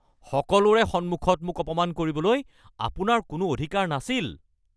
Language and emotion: Assamese, angry